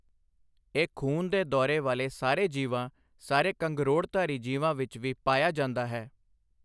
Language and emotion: Punjabi, neutral